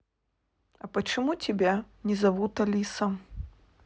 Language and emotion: Russian, neutral